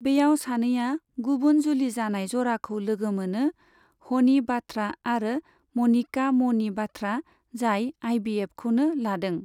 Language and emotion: Bodo, neutral